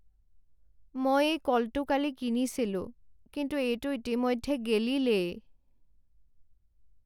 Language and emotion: Assamese, sad